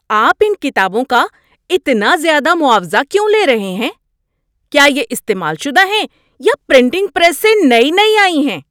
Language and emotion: Urdu, angry